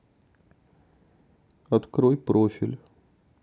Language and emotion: Russian, sad